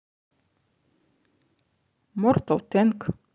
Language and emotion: Russian, positive